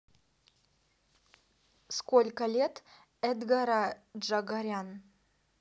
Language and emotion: Russian, neutral